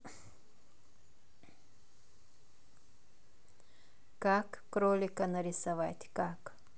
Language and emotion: Russian, neutral